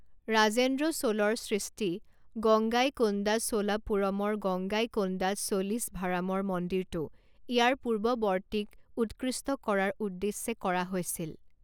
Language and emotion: Assamese, neutral